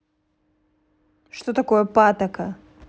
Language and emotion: Russian, neutral